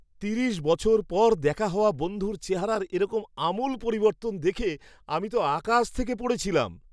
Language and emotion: Bengali, surprised